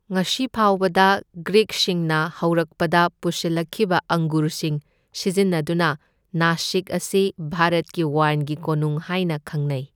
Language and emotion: Manipuri, neutral